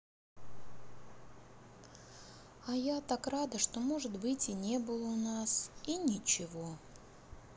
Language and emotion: Russian, sad